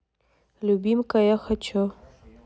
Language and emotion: Russian, neutral